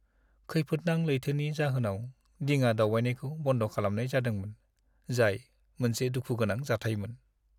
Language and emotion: Bodo, sad